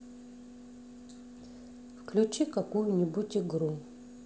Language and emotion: Russian, neutral